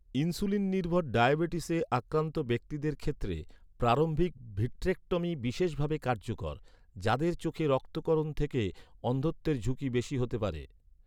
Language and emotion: Bengali, neutral